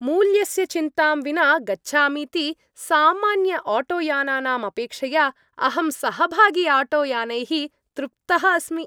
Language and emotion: Sanskrit, happy